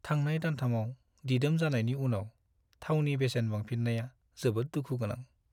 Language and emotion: Bodo, sad